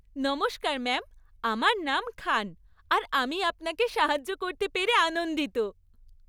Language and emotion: Bengali, happy